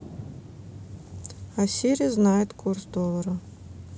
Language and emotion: Russian, neutral